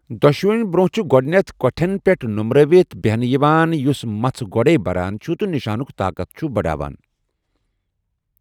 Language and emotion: Kashmiri, neutral